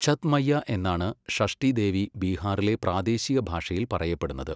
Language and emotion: Malayalam, neutral